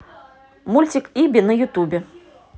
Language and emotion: Russian, positive